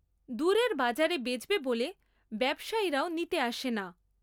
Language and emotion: Bengali, neutral